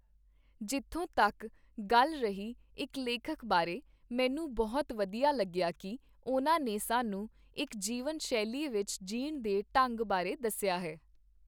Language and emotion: Punjabi, neutral